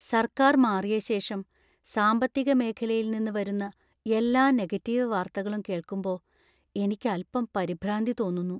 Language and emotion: Malayalam, fearful